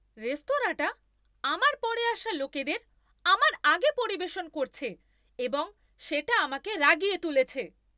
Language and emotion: Bengali, angry